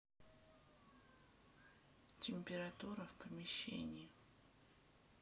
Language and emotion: Russian, neutral